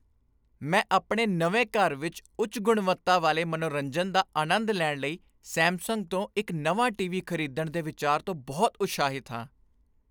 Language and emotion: Punjabi, happy